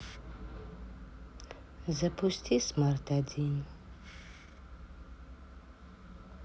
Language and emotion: Russian, sad